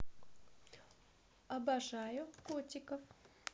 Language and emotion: Russian, positive